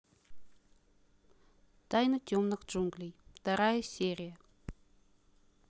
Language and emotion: Russian, neutral